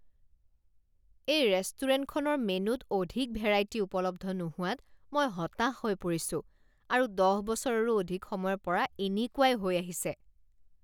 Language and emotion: Assamese, disgusted